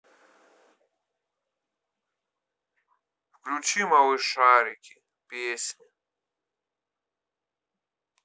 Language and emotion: Russian, sad